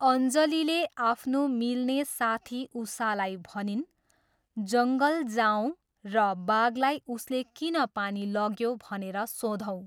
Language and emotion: Nepali, neutral